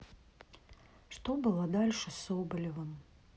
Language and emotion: Russian, sad